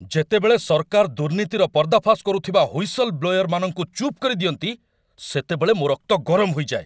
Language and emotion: Odia, angry